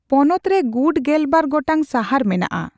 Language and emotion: Santali, neutral